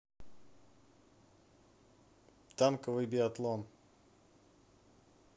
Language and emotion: Russian, neutral